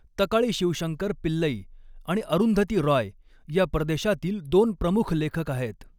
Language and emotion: Marathi, neutral